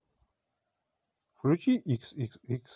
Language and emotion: Russian, neutral